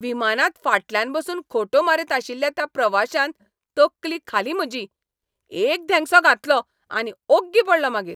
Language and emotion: Goan Konkani, angry